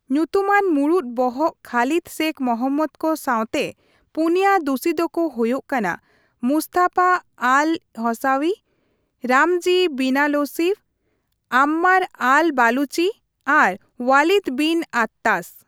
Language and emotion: Santali, neutral